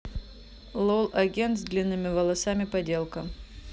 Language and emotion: Russian, neutral